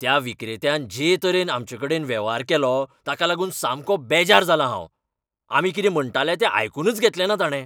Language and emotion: Goan Konkani, angry